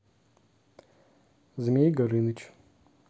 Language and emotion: Russian, neutral